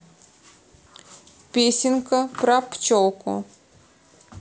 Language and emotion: Russian, neutral